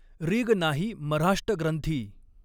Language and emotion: Marathi, neutral